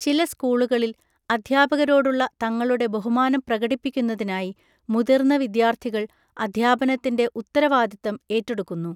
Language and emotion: Malayalam, neutral